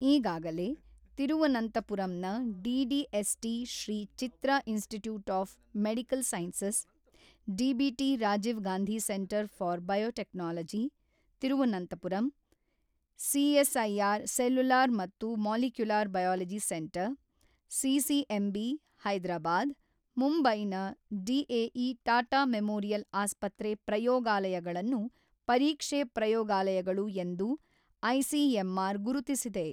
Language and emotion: Kannada, neutral